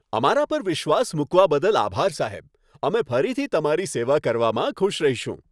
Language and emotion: Gujarati, happy